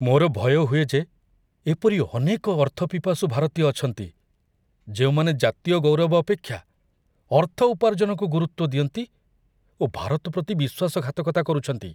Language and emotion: Odia, fearful